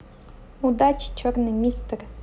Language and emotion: Russian, neutral